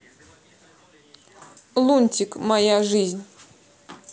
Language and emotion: Russian, neutral